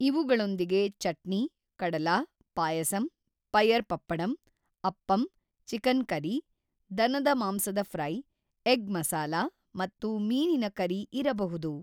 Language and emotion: Kannada, neutral